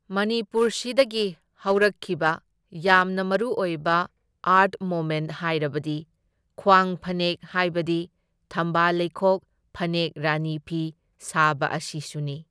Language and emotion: Manipuri, neutral